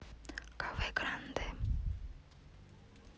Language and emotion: Russian, neutral